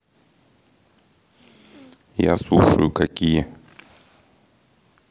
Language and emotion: Russian, neutral